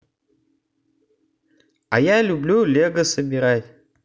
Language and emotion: Russian, positive